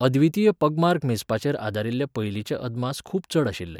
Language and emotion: Goan Konkani, neutral